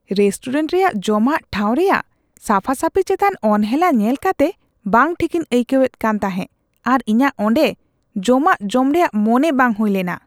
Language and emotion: Santali, disgusted